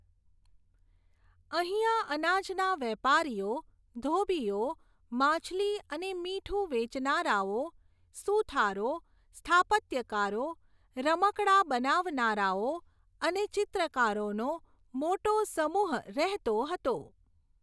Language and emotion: Gujarati, neutral